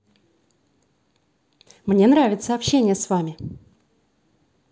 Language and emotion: Russian, positive